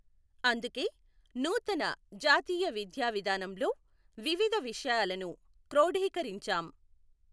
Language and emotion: Telugu, neutral